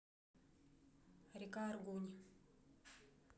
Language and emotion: Russian, neutral